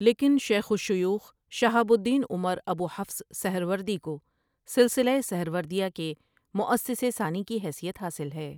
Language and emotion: Urdu, neutral